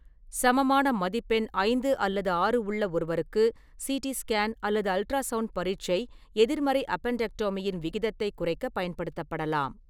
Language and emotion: Tamil, neutral